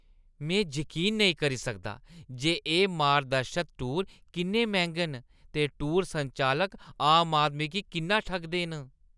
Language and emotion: Dogri, disgusted